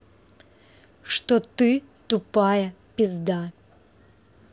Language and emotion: Russian, angry